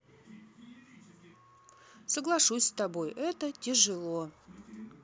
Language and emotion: Russian, neutral